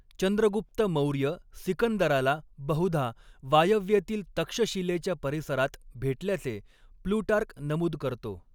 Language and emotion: Marathi, neutral